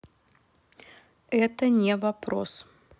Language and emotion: Russian, neutral